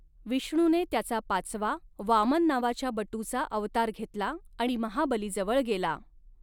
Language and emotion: Marathi, neutral